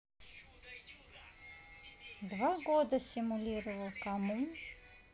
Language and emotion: Russian, neutral